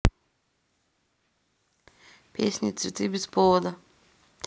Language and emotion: Russian, neutral